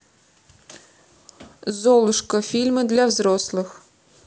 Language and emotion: Russian, neutral